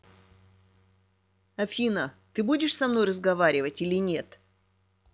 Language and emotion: Russian, angry